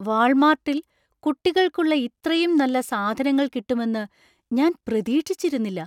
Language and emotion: Malayalam, surprised